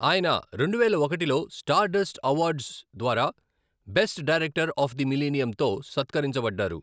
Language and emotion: Telugu, neutral